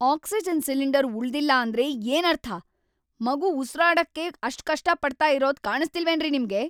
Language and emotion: Kannada, angry